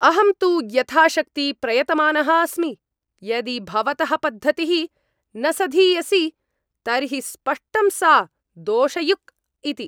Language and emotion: Sanskrit, angry